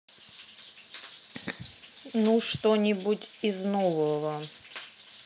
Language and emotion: Russian, neutral